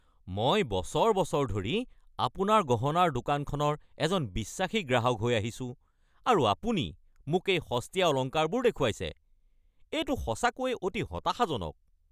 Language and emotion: Assamese, angry